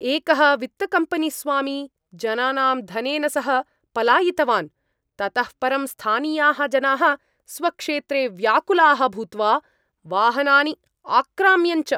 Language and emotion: Sanskrit, angry